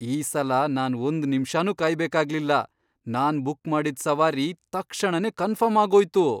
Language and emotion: Kannada, surprised